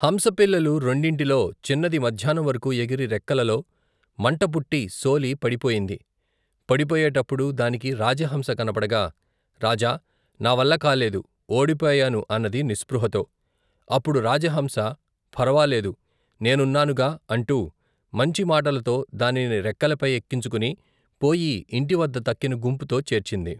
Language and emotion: Telugu, neutral